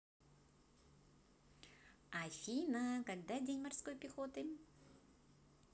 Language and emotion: Russian, positive